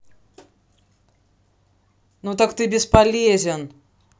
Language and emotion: Russian, angry